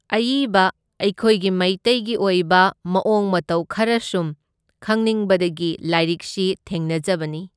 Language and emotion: Manipuri, neutral